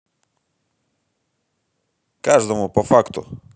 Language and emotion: Russian, positive